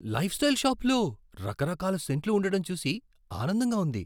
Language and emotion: Telugu, surprised